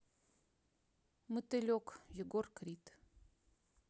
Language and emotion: Russian, neutral